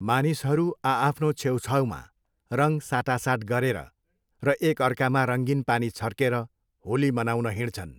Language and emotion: Nepali, neutral